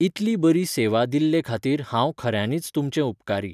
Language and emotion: Goan Konkani, neutral